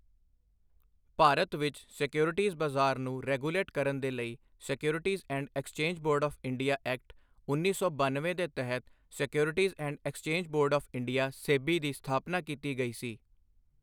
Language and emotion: Punjabi, neutral